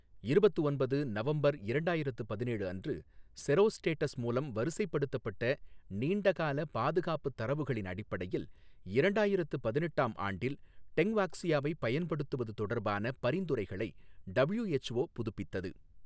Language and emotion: Tamil, neutral